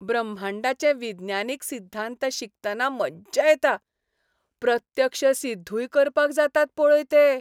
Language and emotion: Goan Konkani, happy